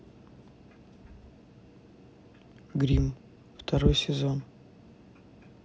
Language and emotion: Russian, neutral